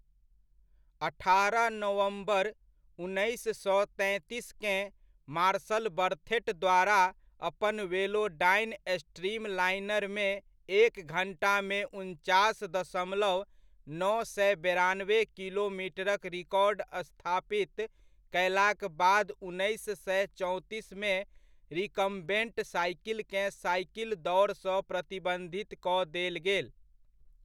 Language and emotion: Maithili, neutral